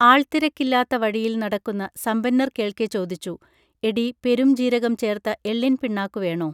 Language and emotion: Malayalam, neutral